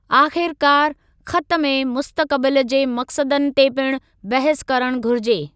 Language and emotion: Sindhi, neutral